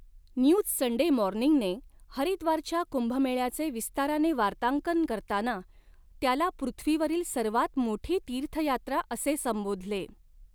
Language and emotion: Marathi, neutral